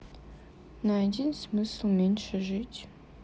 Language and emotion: Russian, sad